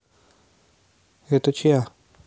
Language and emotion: Russian, neutral